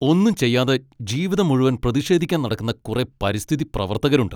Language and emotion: Malayalam, angry